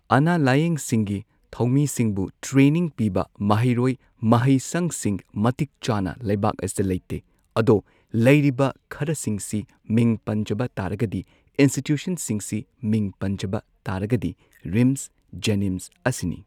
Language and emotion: Manipuri, neutral